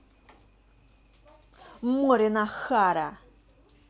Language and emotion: Russian, angry